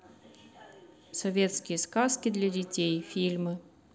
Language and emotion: Russian, neutral